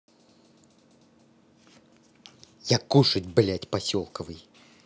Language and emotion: Russian, angry